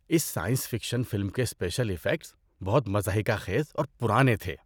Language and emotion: Urdu, disgusted